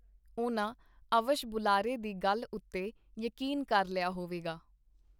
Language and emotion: Punjabi, neutral